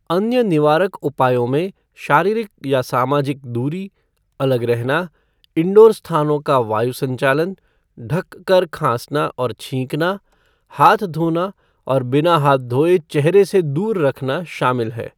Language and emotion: Hindi, neutral